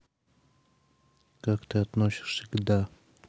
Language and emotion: Russian, neutral